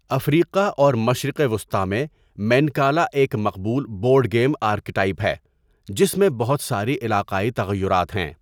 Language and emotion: Urdu, neutral